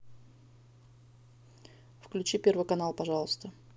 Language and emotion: Russian, neutral